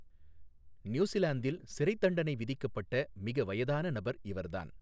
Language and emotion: Tamil, neutral